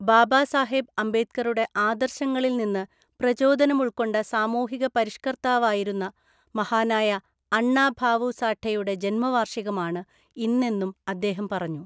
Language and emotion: Malayalam, neutral